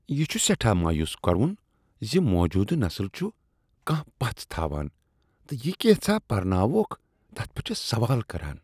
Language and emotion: Kashmiri, disgusted